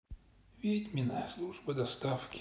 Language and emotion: Russian, sad